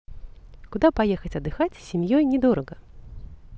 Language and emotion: Russian, positive